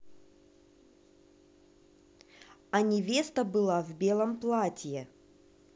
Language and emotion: Russian, neutral